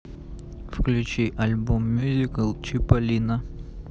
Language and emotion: Russian, neutral